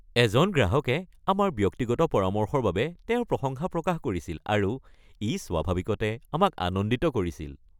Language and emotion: Assamese, happy